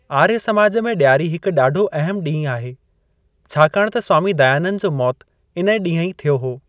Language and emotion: Sindhi, neutral